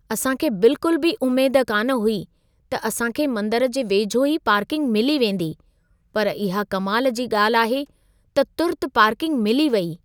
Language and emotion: Sindhi, surprised